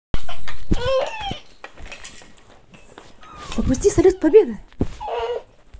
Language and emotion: Russian, positive